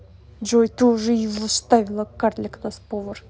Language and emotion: Russian, angry